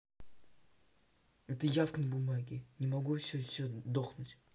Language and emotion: Russian, angry